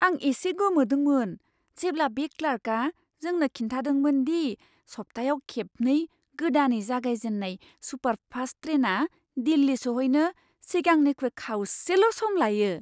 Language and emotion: Bodo, surprised